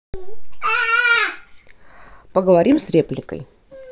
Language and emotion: Russian, neutral